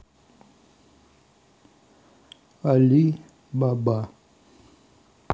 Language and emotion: Russian, neutral